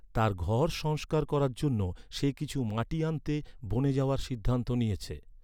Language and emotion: Bengali, neutral